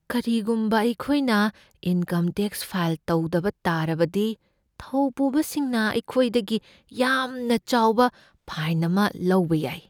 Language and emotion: Manipuri, fearful